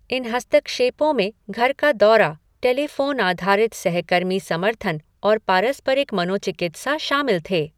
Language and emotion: Hindi, neutral